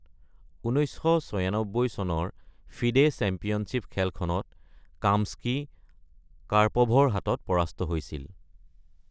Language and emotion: Assamese, neutral